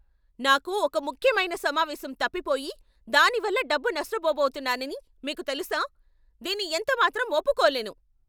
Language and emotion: Telugu, angry